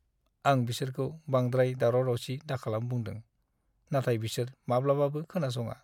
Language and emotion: Bodo, sad